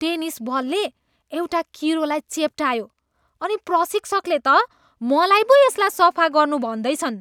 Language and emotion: Nepali, disgusted